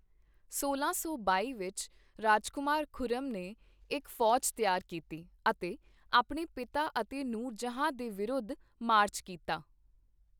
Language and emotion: Punjabi, neutral